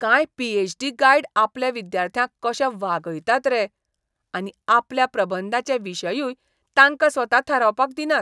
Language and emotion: Goan Konkani, disgusted